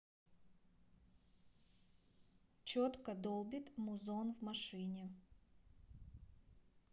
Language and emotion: Russian, neutral